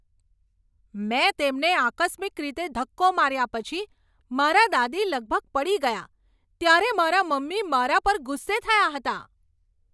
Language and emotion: Gujarati, angry